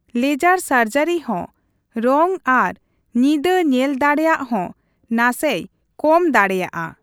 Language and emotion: Santali, neutral